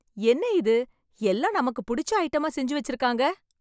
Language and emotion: Tamil, happy